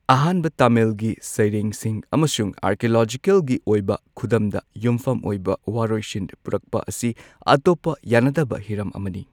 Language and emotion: Manipuri, neutral